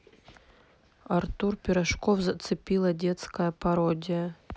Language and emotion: Russian, neutral